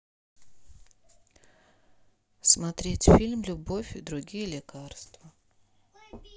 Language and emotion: Russian, neutral